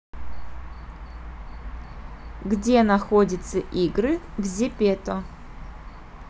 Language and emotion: Russian, neutral